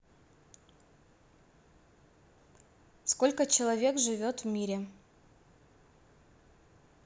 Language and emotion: Russian, neutral